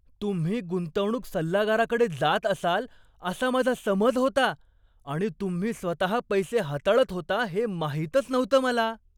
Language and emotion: Marathi, surprised